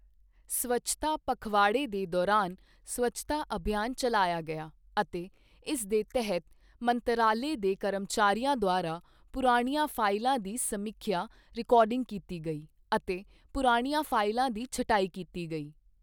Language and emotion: Punjabi, neutral